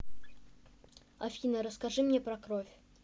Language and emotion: Russian, neutral